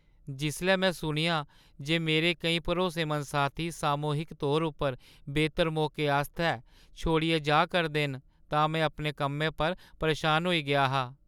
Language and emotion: Dogri, sad